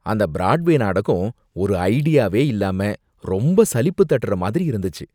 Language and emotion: Tamil, disgusted